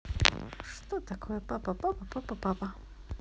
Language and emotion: Russian, positive